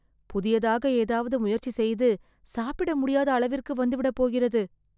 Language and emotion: Tamil, fearful